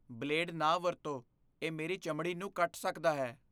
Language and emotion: Punjabi, fearful